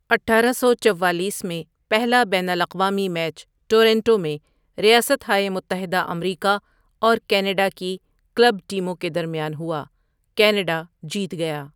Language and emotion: Urdu, neutral